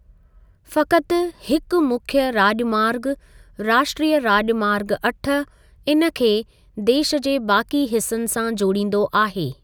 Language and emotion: Sindhi, neutral